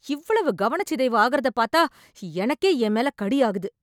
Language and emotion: Tamil, angry